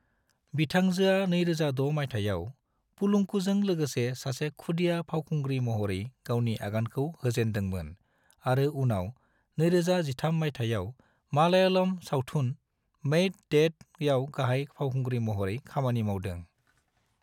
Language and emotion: Bodo, neutral